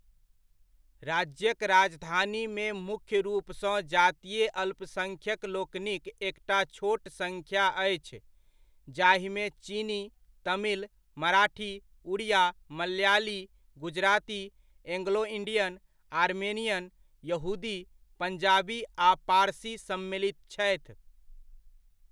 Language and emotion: Maithili, neutral